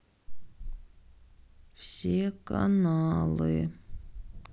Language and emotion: Russian, sad